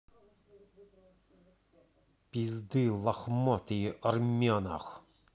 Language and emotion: Russian, angry